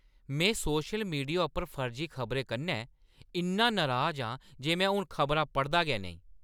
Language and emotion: Dogri, angry